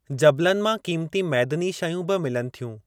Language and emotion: Sindhi, neutral